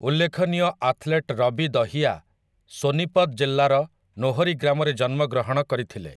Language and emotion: Odia, neutral